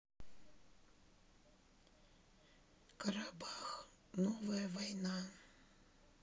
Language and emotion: Russian, sad